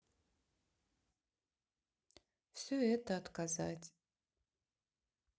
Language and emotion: Russian, sad